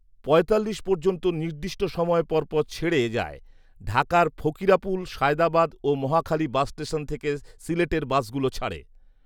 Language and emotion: Bengali, neutral